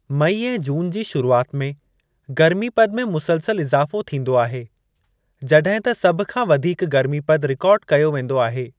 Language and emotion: Sindhi, neutral